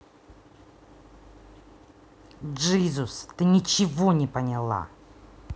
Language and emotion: Russian, angry